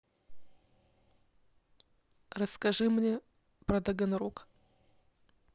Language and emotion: Russian, neutral